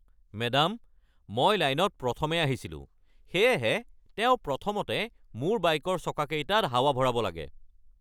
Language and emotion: Assamese, angry